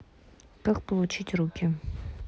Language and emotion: Russian, neutral